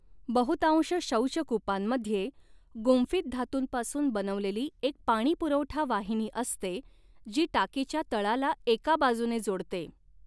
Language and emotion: Marathi, neutral